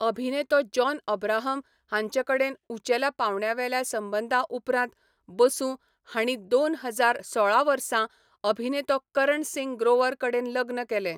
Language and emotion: Goan Konkani, neutral